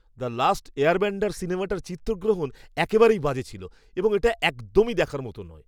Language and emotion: Bengali, disgusted